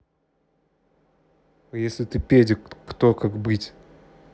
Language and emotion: Russian, angry